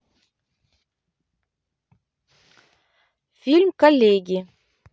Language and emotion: Russian, neutral